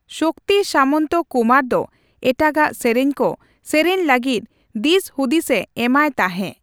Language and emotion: Santali, neutral